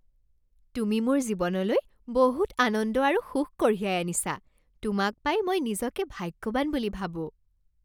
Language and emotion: Assamese, happy